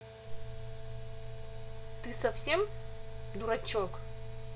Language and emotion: Russian, angry